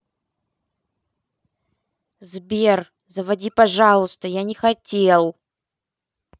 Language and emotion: Russian, angry